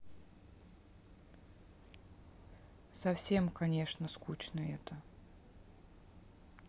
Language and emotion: Russian, sad